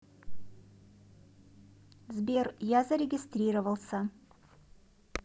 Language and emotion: Russian, neutral